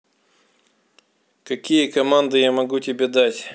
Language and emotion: Russian, neutral